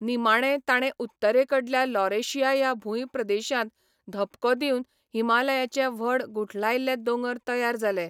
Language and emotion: Goan Konkani, neutral